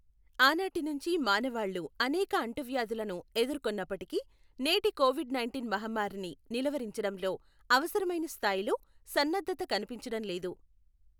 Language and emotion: Telugu, neutral